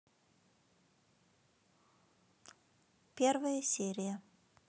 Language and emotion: Russian, neutral